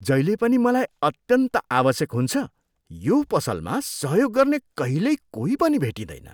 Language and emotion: Nepali, disgusted